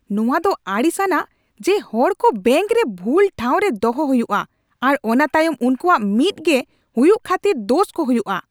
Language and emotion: Santali, angry